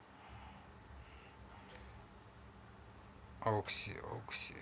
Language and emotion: Russian, neutral